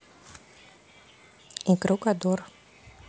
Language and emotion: Russian, neutral